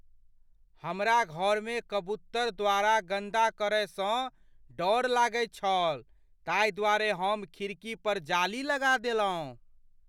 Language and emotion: Maithili, fearful